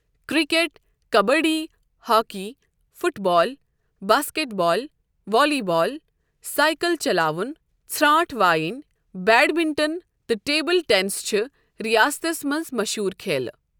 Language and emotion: Kashmiri, neutral